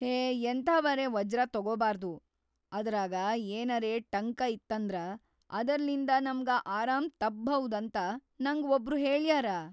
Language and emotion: Kannada, fearful